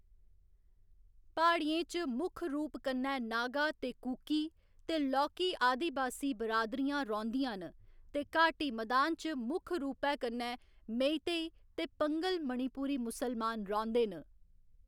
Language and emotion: Dogri, neutral